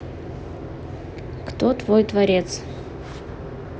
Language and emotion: Russian, neutral